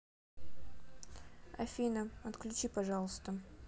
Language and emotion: Russian, neutral